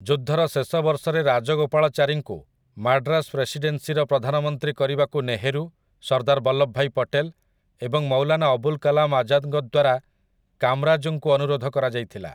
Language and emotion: Odia, neutral